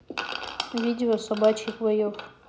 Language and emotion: Russian, neutral